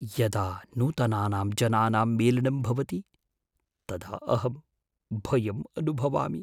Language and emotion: Sanskrit, fearful